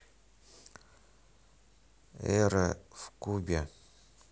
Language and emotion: Russian, neutral